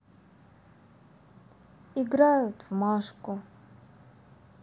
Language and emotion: Russian, sad